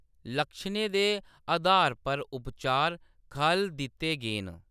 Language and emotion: Dogri, neutral